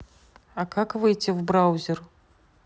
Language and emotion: Russian, neutral